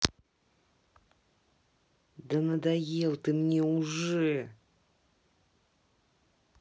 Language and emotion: Russian, angry